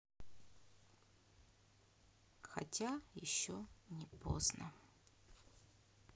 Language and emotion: Russian, sad